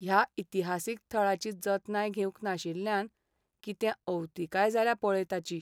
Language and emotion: Goan Konkani, sad